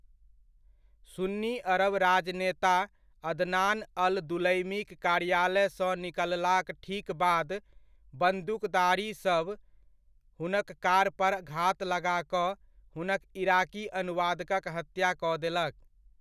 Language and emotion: Maithili, neutral